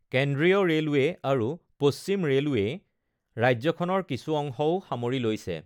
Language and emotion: Assamese, neutral